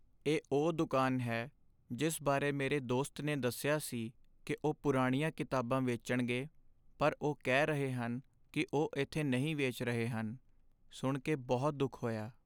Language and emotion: Punjabi, sad